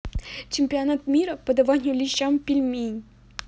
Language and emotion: Russian, positive